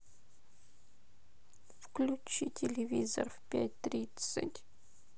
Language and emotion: Russian, sad